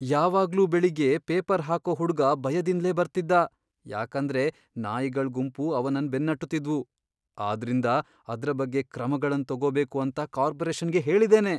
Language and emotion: Kannada, fearful